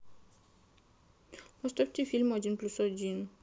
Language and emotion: Russian, sad